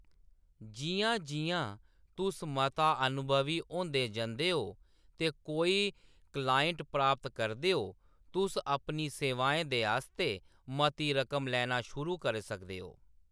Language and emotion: Dogri, neutral